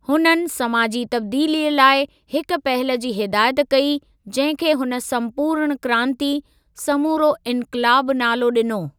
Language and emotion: Sindhi, neutral